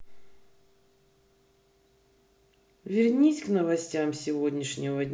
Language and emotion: Russian, neutral